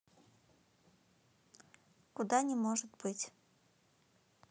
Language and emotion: Russian, neutral